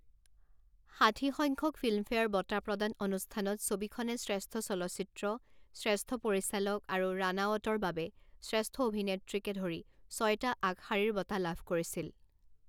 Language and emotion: Assamese, neutral